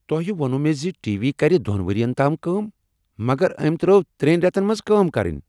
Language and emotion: Kashmiri, angry